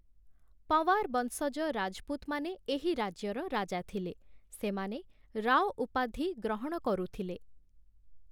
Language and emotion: Odia, neutral